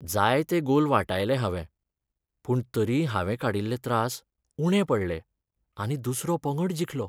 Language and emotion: Goan Konkani, sad